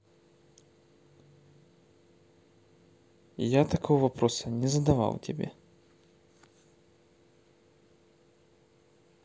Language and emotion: Russian, neutral